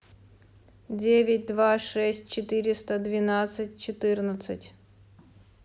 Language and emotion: Russian, neutral